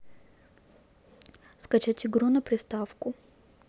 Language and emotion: Russian, neutral